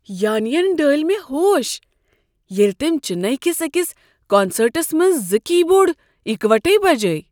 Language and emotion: Kashmiri, surprised